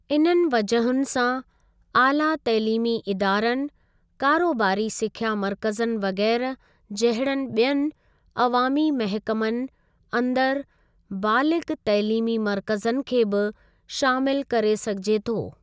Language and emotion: Sindhi, neutral